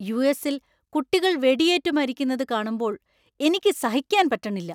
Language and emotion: Malayalam, angry